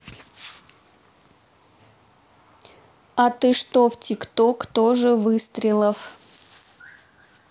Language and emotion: Russian, neutral